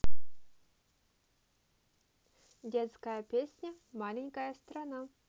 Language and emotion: Russian, neutral